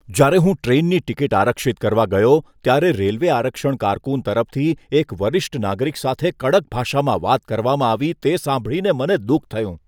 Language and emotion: Gujarati, disgusted